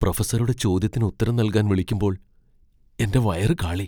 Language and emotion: Malayalam, fearful